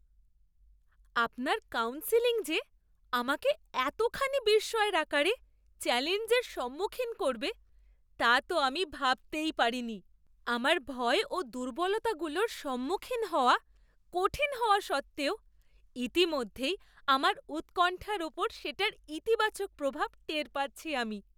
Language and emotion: Bengali, surprised